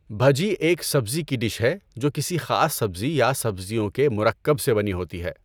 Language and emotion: Urdu, neutral